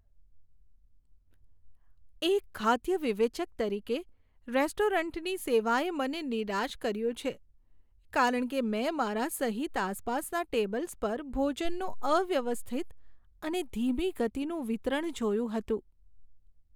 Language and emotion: Gujarati, sad